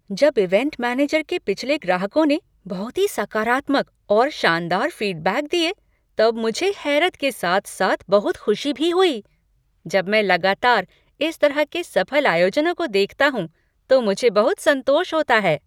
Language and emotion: Hindi, surprised